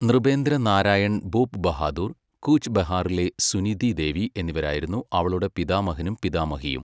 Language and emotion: Malayalam, neutral